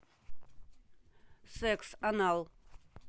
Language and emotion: Russian, neutral